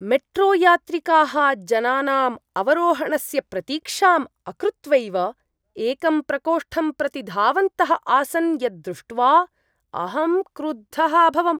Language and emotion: Sanskrit, disgusted